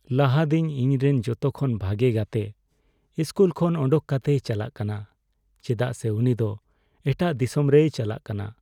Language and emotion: Santali, sad